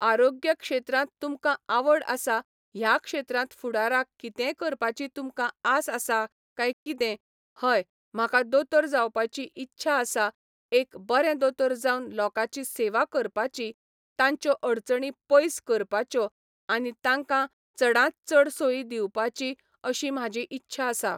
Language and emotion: Goan Konkani, neutral